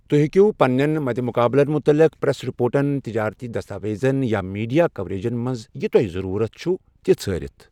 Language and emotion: Kashmiri, neutral